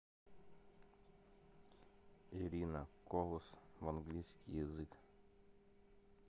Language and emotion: Russian, neutral